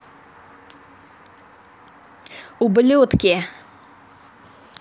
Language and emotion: Russian, angry